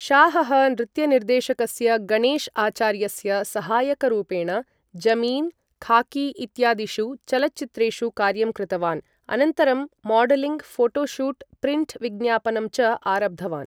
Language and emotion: Sanskrit, neutral